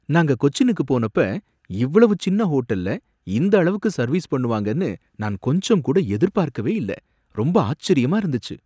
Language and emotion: Tamil, surprised